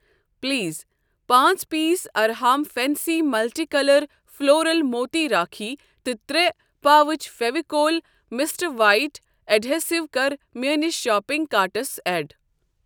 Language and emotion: Kashmiri, neutral